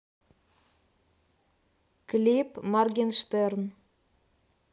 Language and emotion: Russian, neutral